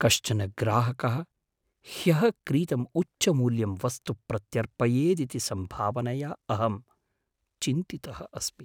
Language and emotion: Sanskrit, fearful